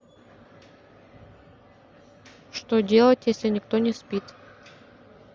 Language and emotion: Russian, neutral